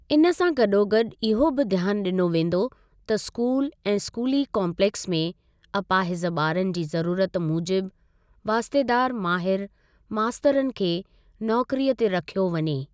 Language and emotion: Sindhi, neutral